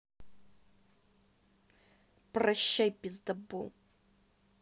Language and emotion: Russian, angry